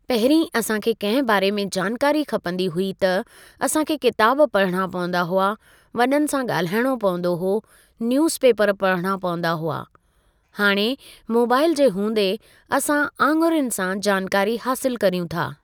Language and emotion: Sindhi, neutral